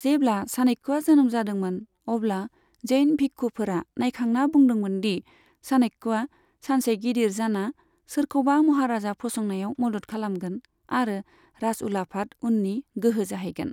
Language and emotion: Bodo, neutral